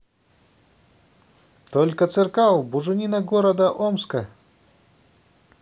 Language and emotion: Russian, positive